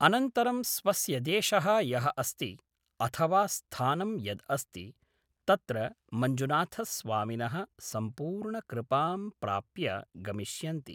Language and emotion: Sanskrit, neutral